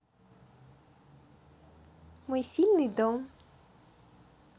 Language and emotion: Russian, positive